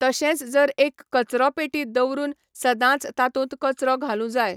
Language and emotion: Goan Konkani, neutral